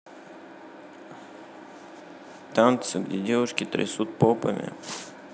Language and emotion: Russian, neutral